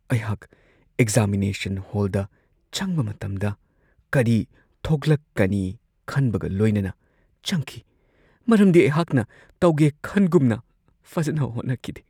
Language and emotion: Manipuri, fearful